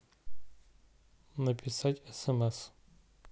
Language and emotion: Russian, neutral